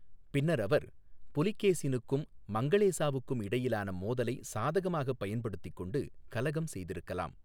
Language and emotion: Tamil, neutral